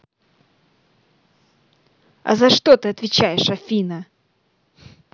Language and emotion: Russian, angry